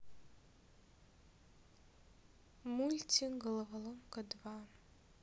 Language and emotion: Russian, sad